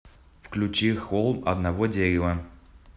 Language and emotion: Russian, neutral